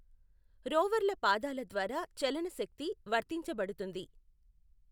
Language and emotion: Telugu, neutral